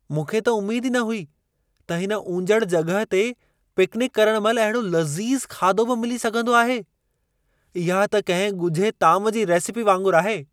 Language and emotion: Sindhi, surprised